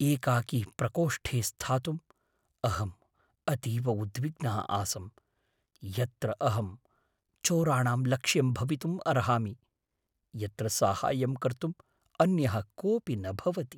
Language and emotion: Sanskrit, fearful